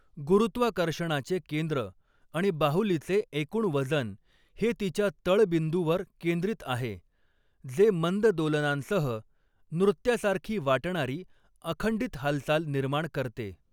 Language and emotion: Marathi, neutral